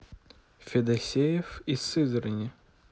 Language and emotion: Russian, neutral